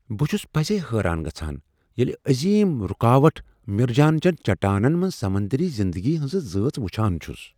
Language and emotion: Kashmiri, surprised